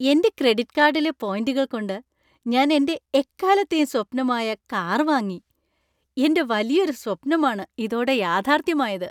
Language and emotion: Malayalam, happy